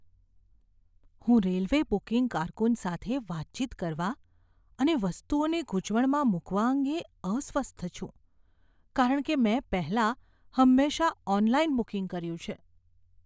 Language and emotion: Gujarati, fearful